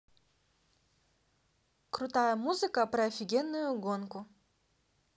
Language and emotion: Russian, neutral